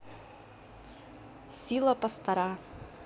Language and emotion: Russian, neutral